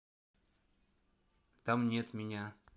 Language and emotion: Russian, neutral